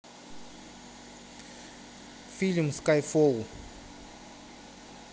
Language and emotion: Russian, neutral